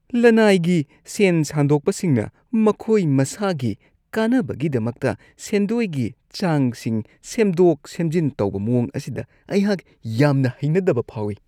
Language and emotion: Manipuri, disgusted